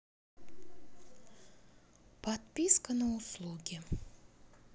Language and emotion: Russian, neutral